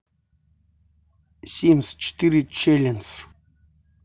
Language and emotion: Russian, neutral